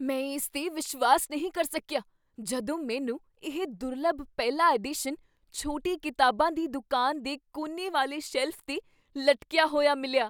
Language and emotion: Punjabi, surprised